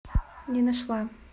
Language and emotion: Russian, neutral